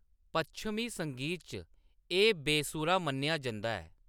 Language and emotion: Dogri, neutral